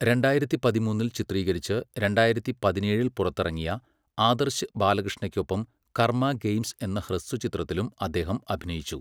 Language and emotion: Malayalam, neutral